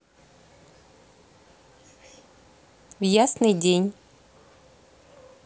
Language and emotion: Russian, neutral